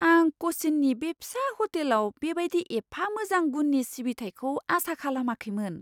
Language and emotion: Bodo, surprised